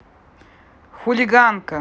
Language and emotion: Russian, angry